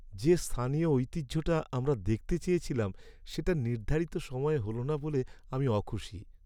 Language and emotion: Bengali, sad